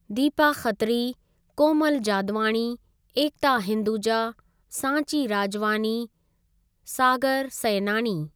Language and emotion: Sindhi, neutral